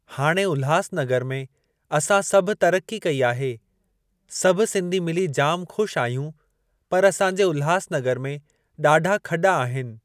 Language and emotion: Sindhi, neutral